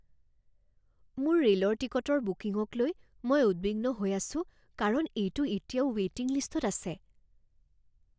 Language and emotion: Assamese, fearful